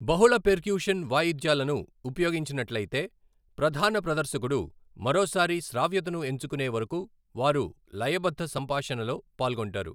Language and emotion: Telugu, neutral